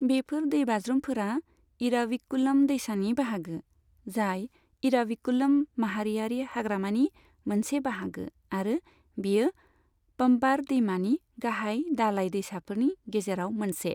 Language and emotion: Bodo, neutral